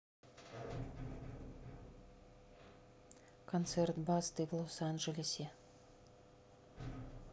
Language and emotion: Russian, neutral